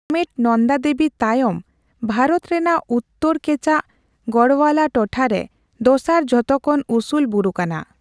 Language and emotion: Santali, neutral